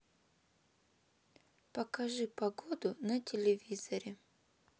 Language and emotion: Russian, sad